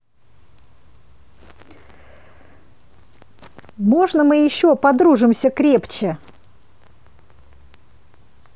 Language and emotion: Russian, positive